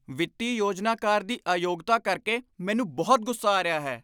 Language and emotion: Punjabi, angry